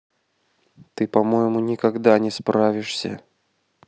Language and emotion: Russian, neutral